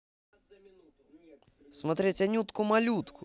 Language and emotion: Russian, positive